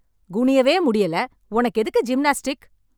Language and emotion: Tamil, angry